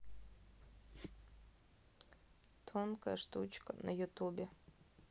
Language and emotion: Russian, neutral